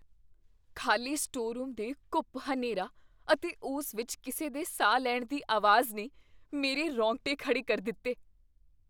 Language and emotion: Punjabi, fearful